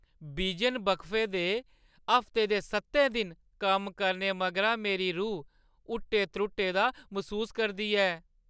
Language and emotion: Dogri, sad